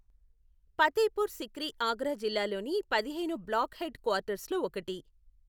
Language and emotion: Telugu, neutral